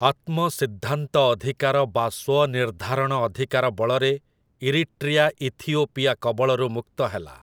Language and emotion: Odia, neutral